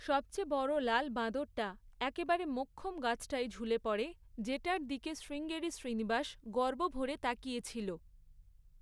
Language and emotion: Bengali, neutral